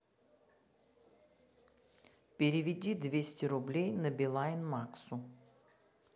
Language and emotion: Russian, neutral